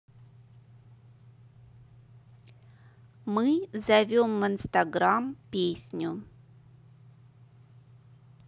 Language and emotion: Russian, neutral